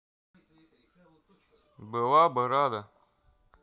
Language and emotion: Russian, neutral